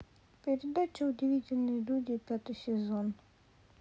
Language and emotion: Russian, sad